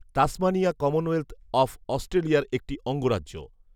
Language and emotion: Bengali, neutral